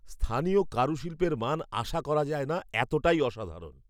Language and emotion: Bengali, surprised